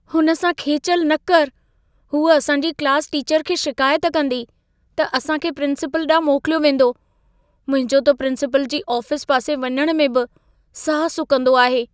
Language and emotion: Sindhi, fearful